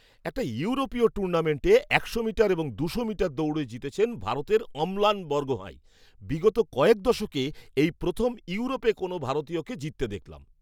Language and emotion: Bengali, surprised